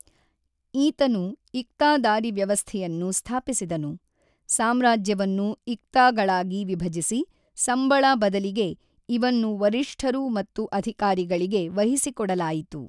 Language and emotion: Kannada, neutral